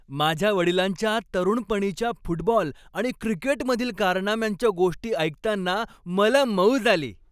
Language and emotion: Marathi, happy